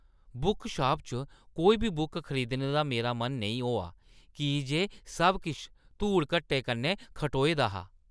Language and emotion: Dogri, disgusted